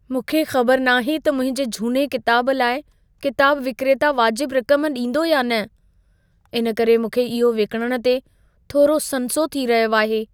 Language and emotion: Sindhi, fearful